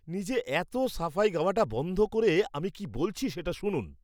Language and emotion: Bengali, angry